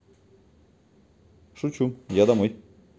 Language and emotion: Russian, neutral